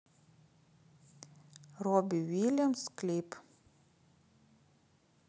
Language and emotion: Russian, neutral